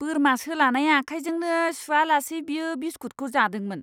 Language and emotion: Bodo, disgusted